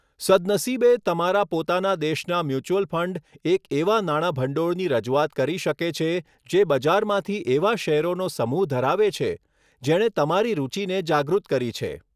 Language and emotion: Gujarati, neutral